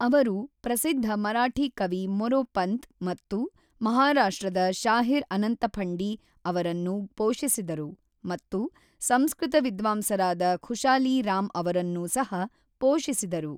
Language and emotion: Kannada, neutral